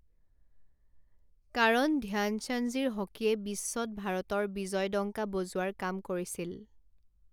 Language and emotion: Assamese, neutral